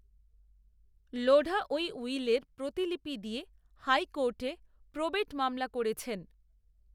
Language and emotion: Bengali, neutral